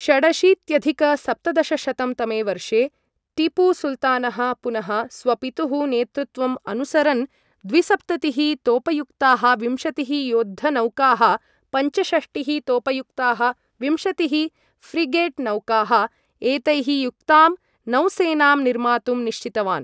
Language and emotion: Sanskrit, neutral